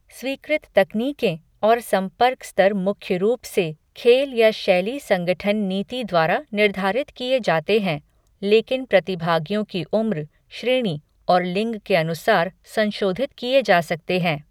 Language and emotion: Hindi, neutral